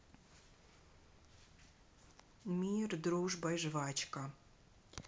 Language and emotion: Russian, neutral